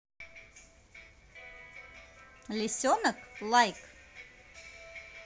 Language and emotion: Russian, positive